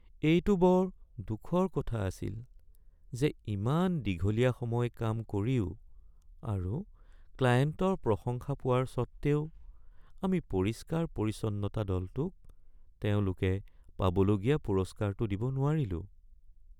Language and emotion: Assamese, sad